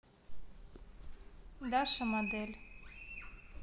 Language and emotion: Russian, neutral